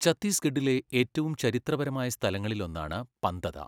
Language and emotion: Malayalam, neutral